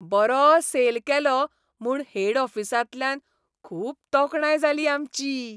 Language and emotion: Goan Konkani, happy